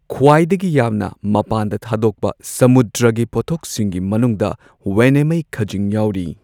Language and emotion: Manipuri, neutral